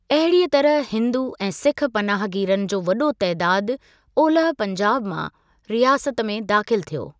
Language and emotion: Sindhi, neutral